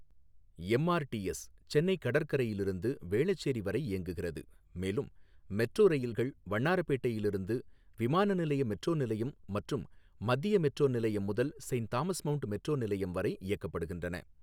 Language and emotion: Tamil, neutral